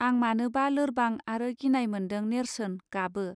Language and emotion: Bodo, neutral